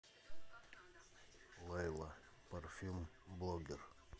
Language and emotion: Russian, neutral